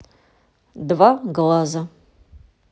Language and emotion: Russian, neutral